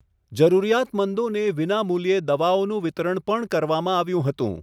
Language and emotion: Gujarati, neutral